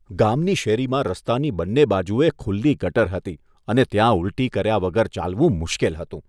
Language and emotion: Gujarati, disgusted